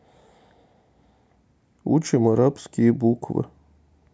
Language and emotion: Russian, neutral